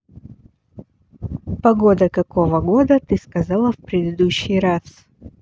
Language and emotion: Russian, neutral